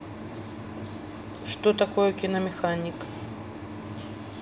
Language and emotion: Russian, neutral